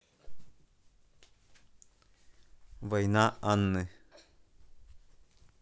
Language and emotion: Russian, neutral